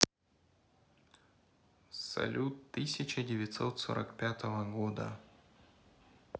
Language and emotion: Russian, neutral